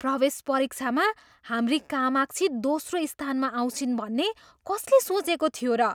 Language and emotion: Nepali, surprised